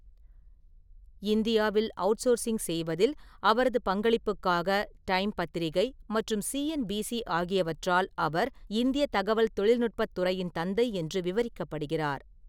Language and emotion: Tamil, neutral